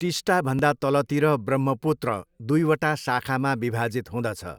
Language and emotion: Nepali, neutral